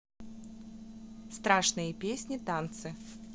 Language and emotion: Russian, neutral